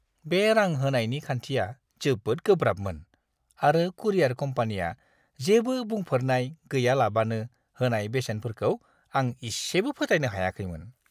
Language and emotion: Bodo, disgusted